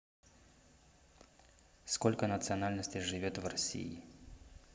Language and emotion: Russian, neutral